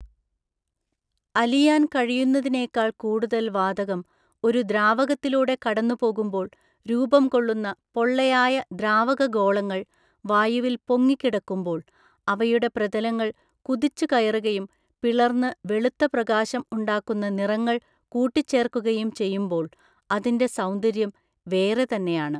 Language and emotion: Malayalam, neutral